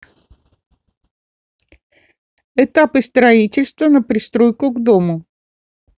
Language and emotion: Russian, neutral